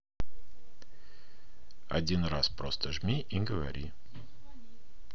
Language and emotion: Russian, neutral